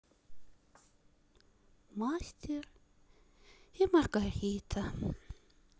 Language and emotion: Russian, sad